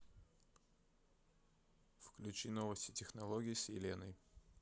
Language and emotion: Russian, neutral